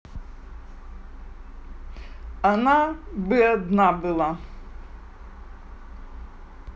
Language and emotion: Russian, neutral